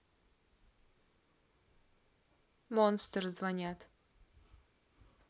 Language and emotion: Russian, neutral